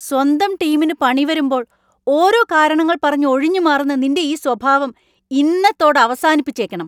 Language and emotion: Malayalam, angry